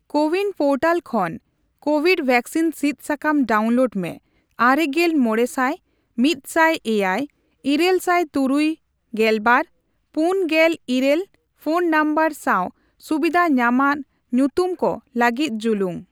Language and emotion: Santali, neutral